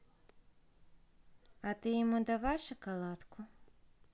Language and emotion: Russian, neutral